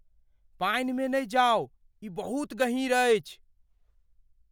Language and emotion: Maithili, fearful